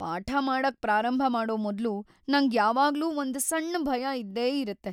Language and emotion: Kannada, fearful